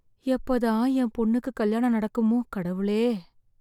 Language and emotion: Tamil, sad